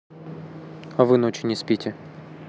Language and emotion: Russian, neutral